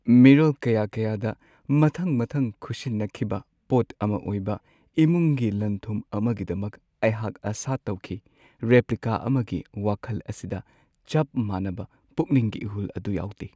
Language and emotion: Manipuri, sad